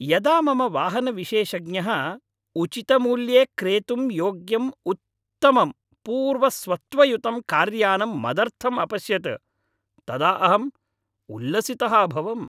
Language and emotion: Sanskrit, happy